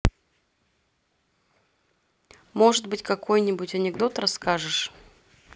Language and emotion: Russian, neutral